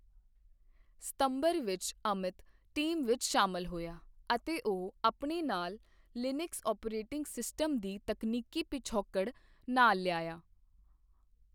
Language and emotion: Punjabi, neutral